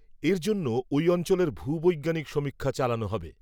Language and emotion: Bengali, neutral